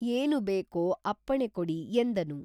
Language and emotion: Kannada, neutral